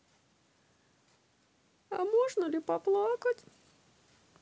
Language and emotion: Russian, sad